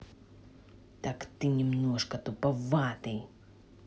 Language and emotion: Russian, angry